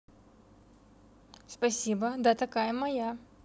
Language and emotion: Russian, neutral